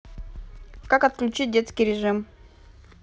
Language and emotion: Russian, neutral